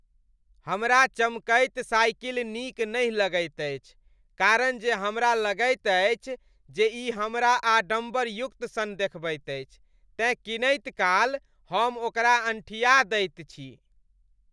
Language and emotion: Maithili, disgusted